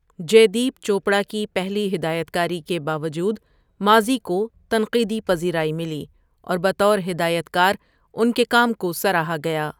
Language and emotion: Urdu, neutral